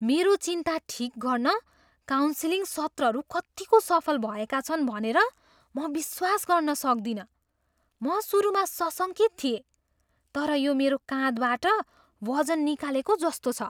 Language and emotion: Nepali, surprised